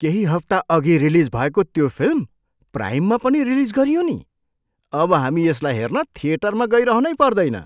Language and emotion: Nepali, surprised